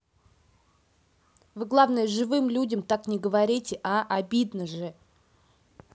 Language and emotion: Russian, angry